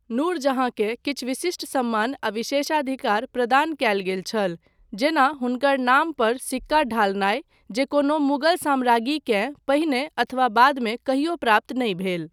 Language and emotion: Maithili, neutral